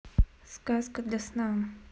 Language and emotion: Russian, neutral